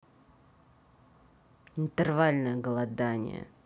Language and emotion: Russian, neutral